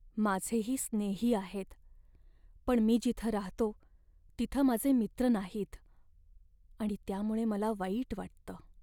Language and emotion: Marathi, sad